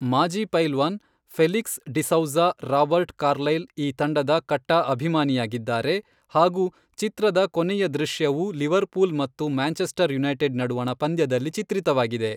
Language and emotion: Kannada, neutral